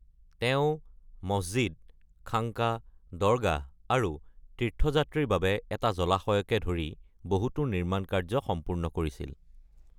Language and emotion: Assamese, neutral